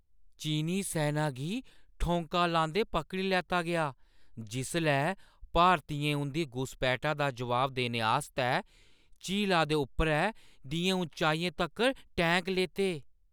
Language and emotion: Dogri, surprised